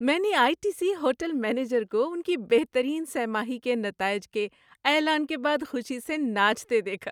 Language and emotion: Urdu, happy